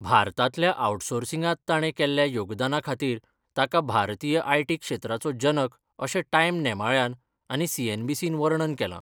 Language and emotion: Goan Konkani, neutral